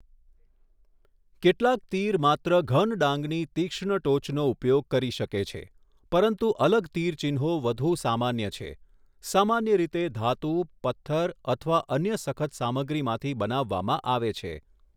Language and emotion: Gujarati, neutral